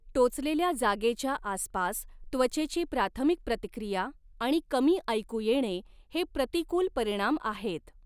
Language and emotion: Marathi, neutral